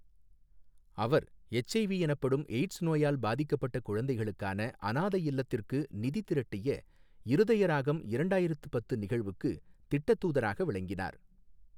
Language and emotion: Tamil, neutral